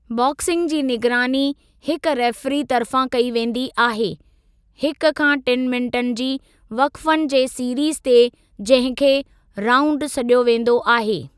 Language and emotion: Sindhi, neutral